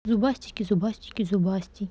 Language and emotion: Russian, neutral